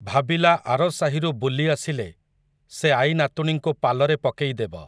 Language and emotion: Odia, neutral